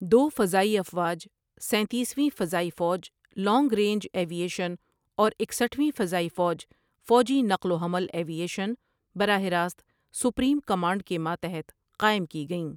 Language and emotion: Urdu, neutral